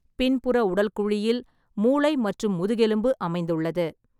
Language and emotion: Tamil, neutral